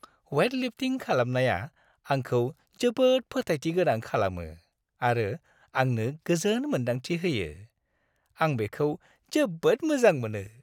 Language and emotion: Bodo, happy